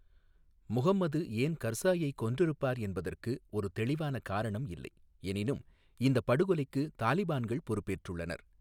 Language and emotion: Tamil, neutral